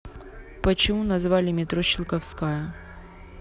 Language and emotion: Russian, neutral